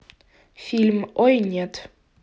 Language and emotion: Russian, neutral